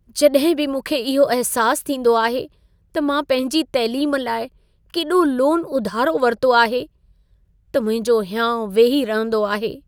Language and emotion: Sindhi, sad